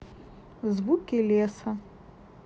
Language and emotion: Russian, neutral